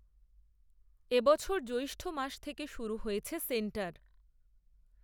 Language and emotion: Bengali, neutral